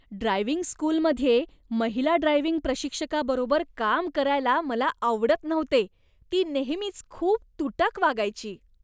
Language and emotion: Marathi, disgusted